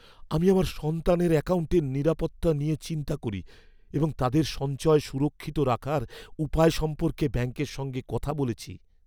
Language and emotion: Bengali, fearful